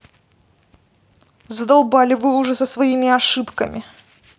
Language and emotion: Russian, angry